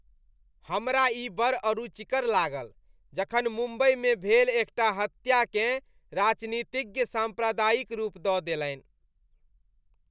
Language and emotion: Maithili, disgusted